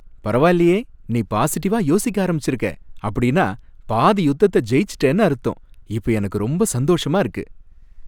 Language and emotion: Tamil, happy